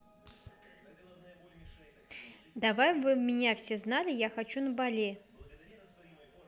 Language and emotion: Russian, neutral